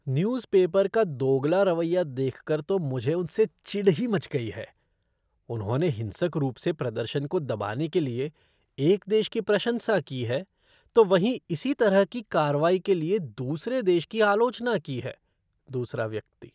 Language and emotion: Hindi, disgusted